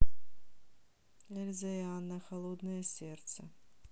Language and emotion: Russian, neutral